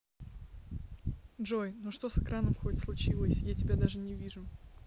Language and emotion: Russian, neutral